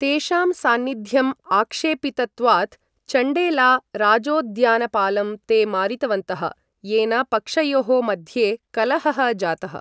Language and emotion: Sanskrit, neutral